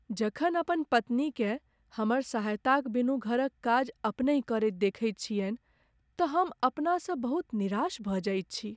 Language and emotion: Maithili, sad